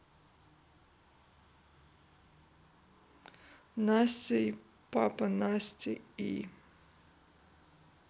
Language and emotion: Russian, sad